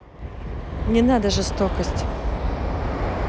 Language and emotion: Russian, neutral